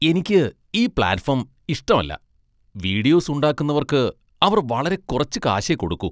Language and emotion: Malayalam, disgusted